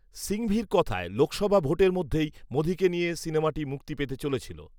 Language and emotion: Bengali, neutral